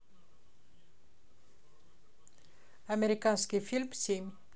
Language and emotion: Russian, neutral